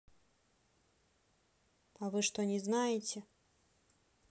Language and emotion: Russian, neutral